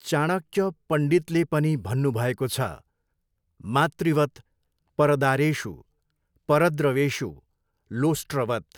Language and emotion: Nepali, neutral